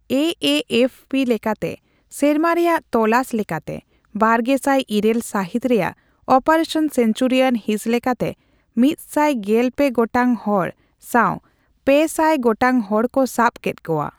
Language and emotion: Santali, neutral